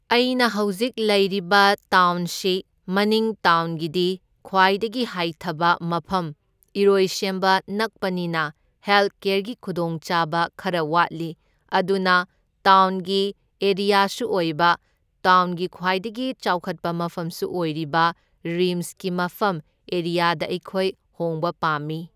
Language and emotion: Manipuri, neutral